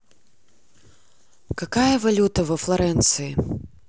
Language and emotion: Russian, neutral